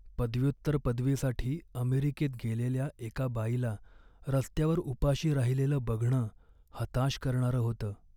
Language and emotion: Marathi, sad